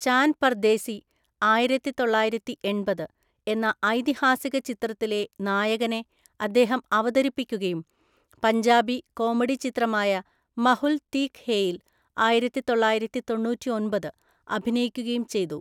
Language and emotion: Malayalam, neutral